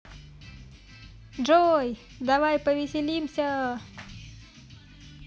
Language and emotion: Russian, positive